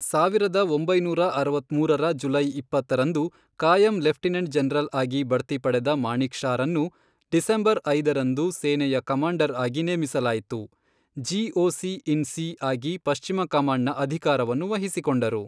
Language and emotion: Kannada, neutral